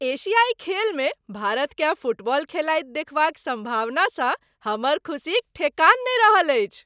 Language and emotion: Maithili, happy